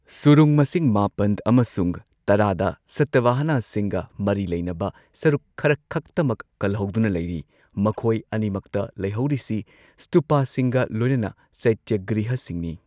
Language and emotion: Manipuri, neutral